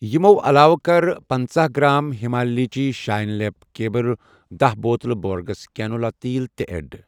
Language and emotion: Kashmiri, neutral